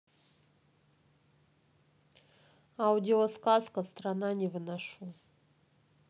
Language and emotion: Russian, neutral